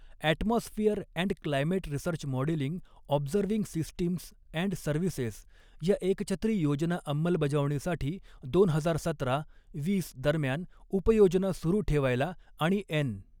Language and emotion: Marathi, neutral